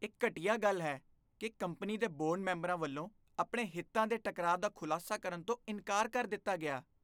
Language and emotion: Punjabi, disgusted